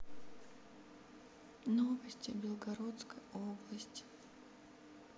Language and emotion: Russian, sad